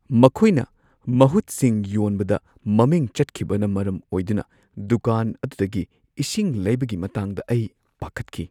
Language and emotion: Manipuri, fearful